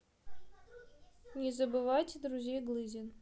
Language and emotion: Russian, neutral